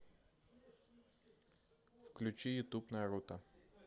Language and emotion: Russian, neutral